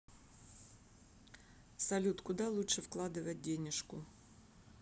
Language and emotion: Russian, neutral